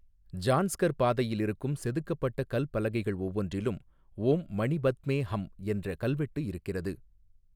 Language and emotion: Tamil, neutral